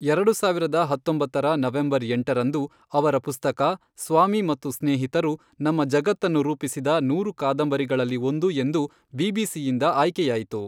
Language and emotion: Kannada, neutral